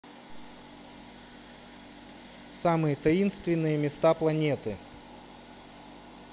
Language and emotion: Russian, neutral